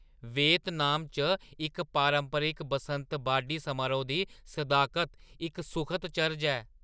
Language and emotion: Dogri, surprised